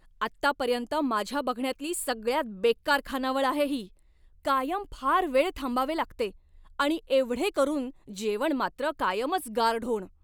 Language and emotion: Marathi, angry